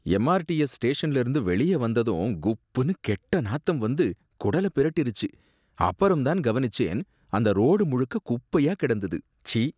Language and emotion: Tamil, disgusted